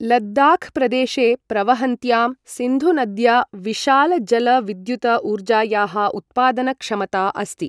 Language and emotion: Sanskrit, neutral